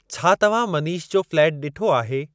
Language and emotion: Sindhi, neutral